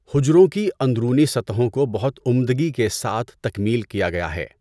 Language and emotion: Urdu, neutral